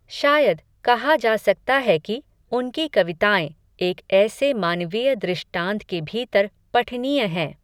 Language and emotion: Hindi, neutral